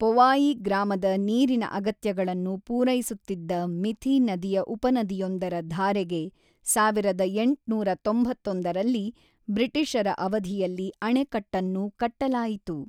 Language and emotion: Kannada, neutral